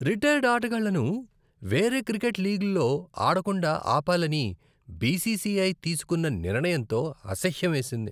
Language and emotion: Telugu, disgusted